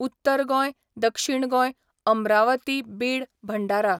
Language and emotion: Goan Konkani, neutral